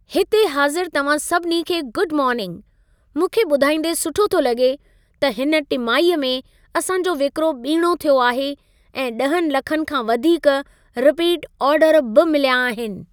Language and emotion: Sindhi, happy